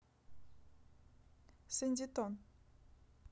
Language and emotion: Russian, neutral